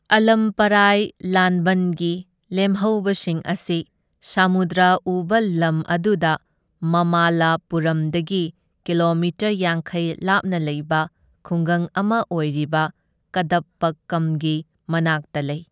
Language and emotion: Manipuri, neutral